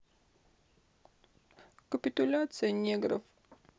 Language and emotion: Russian, sad